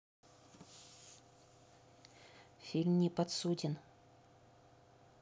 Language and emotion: Russian, neutral